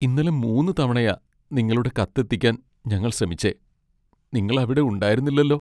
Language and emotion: Malayalam, sad